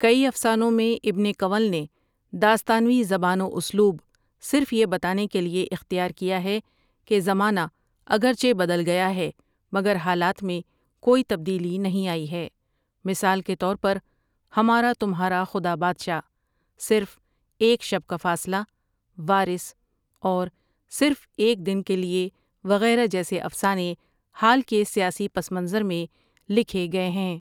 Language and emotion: Urdu, neutral